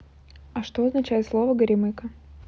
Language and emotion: Russian, neutral